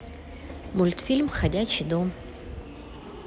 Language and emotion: Russian, neutral